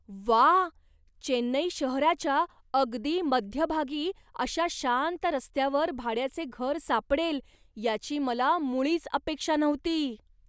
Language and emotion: Marathi, surprised